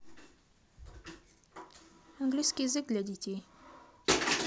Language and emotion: Russian, neutral